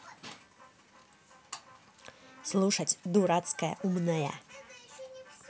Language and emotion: Russian, angry